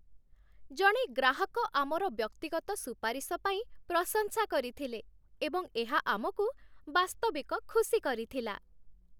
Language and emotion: Odia, happy